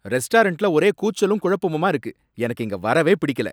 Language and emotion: Tamil, angry